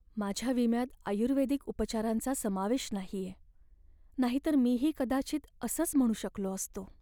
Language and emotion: Marathi, sad